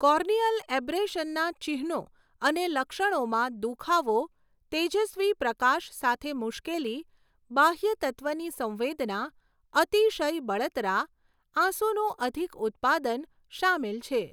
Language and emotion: Gujarati, neutral